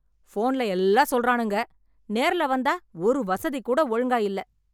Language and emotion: Tamil, angry